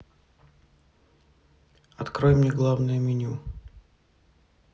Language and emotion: Russian, neutral